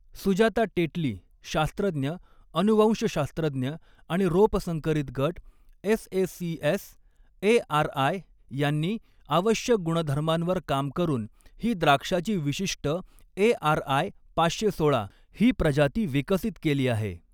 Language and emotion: Marathi, neutral